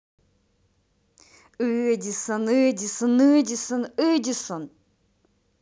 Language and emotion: Russian, angry